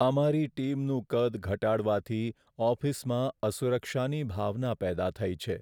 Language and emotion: Gujarati, sad